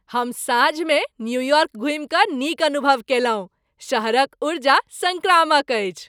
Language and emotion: Maithili, happy